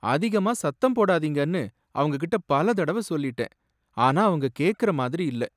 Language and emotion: Tamil, sad